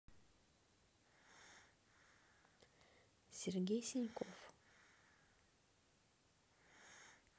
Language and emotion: Russian, neutral